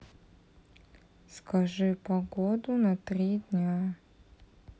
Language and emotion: Russian, neutral